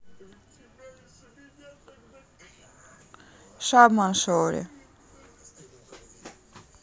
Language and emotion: Russian, neutral